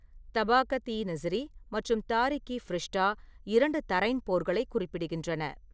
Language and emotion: Tamil, neutral